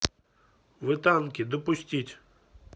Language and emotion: Russian, neutral